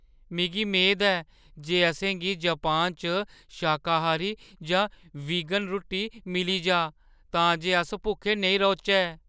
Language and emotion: Dogri, fearful